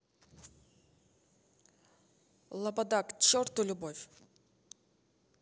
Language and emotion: Russian, angry